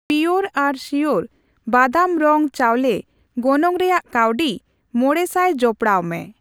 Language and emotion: Santali, neutral